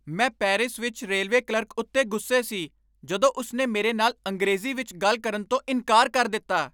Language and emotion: Punjabi, angry